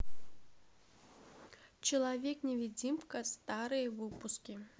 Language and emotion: Russian, neutral